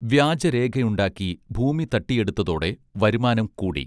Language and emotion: Malayalam, neutral